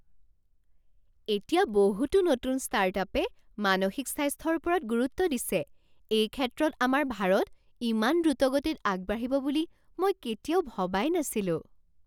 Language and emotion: Assamese, surprised